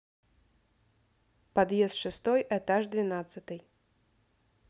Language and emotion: Russian, neutral